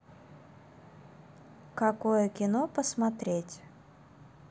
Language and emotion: Russian, neutral